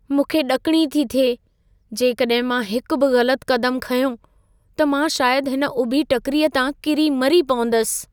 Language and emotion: Sindhi, fearful